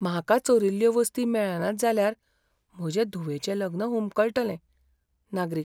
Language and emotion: Goan Konkani, fearful